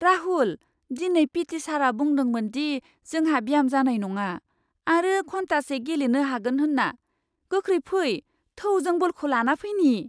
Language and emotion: Bodo, surprised